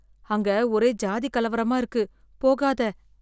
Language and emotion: Tamil, fearful